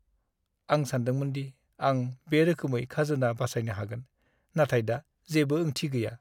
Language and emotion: Bodo, sad